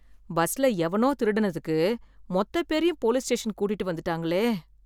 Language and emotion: Tamil, fearful